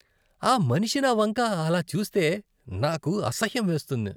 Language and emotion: Telugu, disgusted